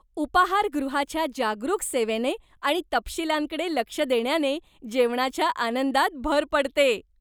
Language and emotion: Marathi, happy